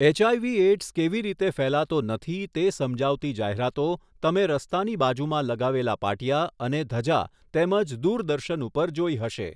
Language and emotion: Gujarati, neutral